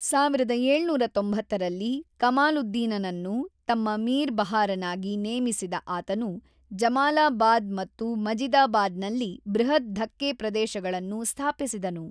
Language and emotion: Kannada, neutral